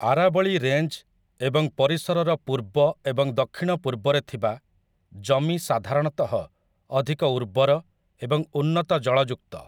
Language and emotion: Odia, neutral